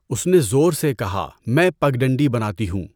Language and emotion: Urdu, neutral